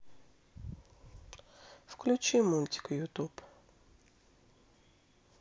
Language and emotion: Russian, sad